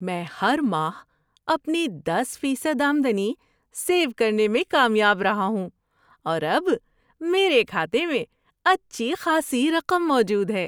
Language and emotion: Urdu, happy